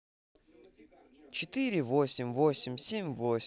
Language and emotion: Russian, neutral